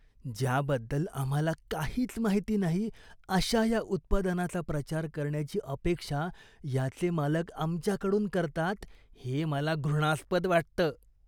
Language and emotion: Marathi, disgusted